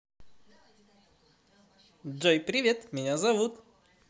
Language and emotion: Russian, positive